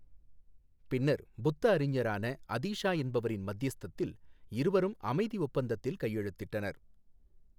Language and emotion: Tamil, neutral